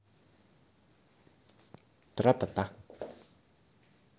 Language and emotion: Russian, positive